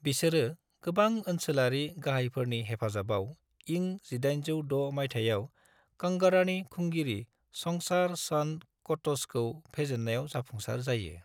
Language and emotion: Bodo, neutral